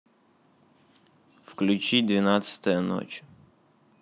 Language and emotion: Russian, neutral